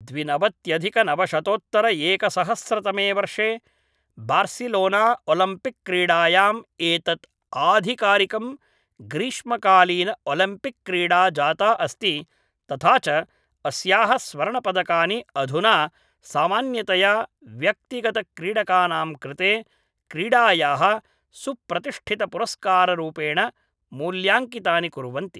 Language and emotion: Sanskrit, neutral